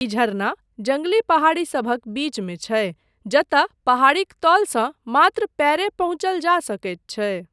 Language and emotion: Maithili, neutral